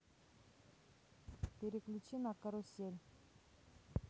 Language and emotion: Russian, neutral